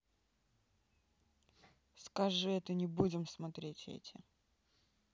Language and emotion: Russian, sad